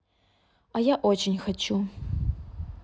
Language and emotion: Russian, neutral